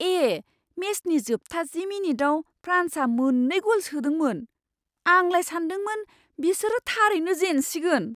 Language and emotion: Bodo, surprised